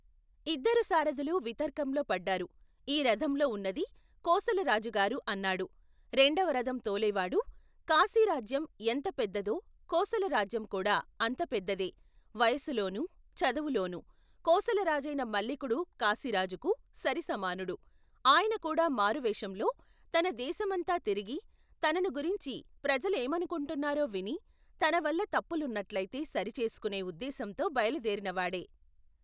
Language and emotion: Telugu, neutral